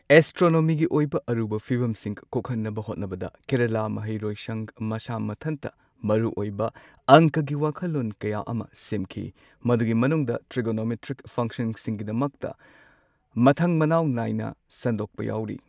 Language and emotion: Manipuri, neutral